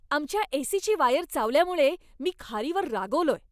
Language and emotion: Marathi, angry